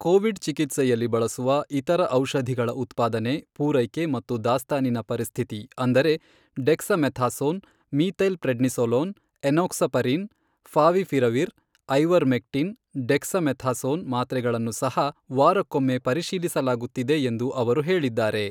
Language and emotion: Kannada, neutral